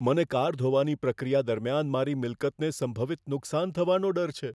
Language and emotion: Gujarati, fearful